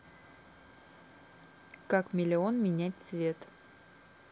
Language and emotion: Russian, neutral